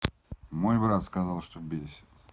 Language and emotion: Russian, neutral